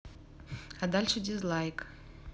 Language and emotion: Russian, neutral